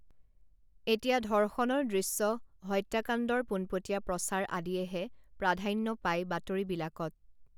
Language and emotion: Assamese, neutral